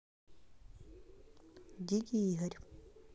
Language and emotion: Russian, neutral